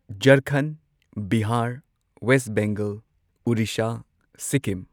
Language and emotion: Manipuri, neutral